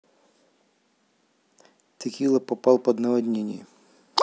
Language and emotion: Russian, neutral